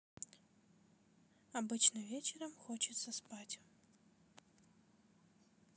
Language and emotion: Russian, neutral